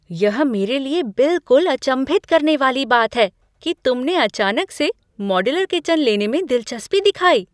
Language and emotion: Hindi, surprised